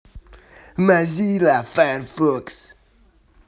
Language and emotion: Russian, angry